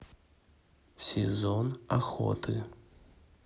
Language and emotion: Russian, neutral